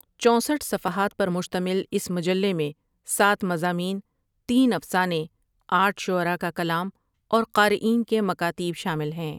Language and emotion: Urdu, neutral